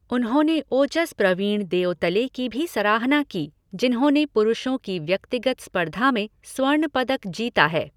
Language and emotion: Hindi, neutral